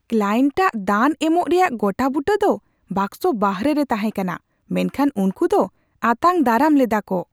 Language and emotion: Santali, surprised